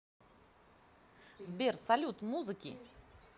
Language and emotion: Russian, positive